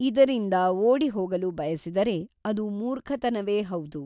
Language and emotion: Kannada, neutral